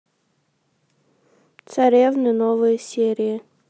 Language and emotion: Russian, neutral